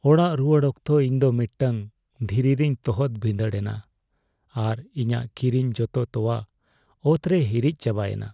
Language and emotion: Santali, sad